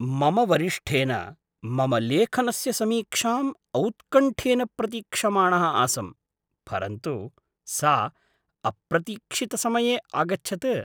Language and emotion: Sanskrit, surprised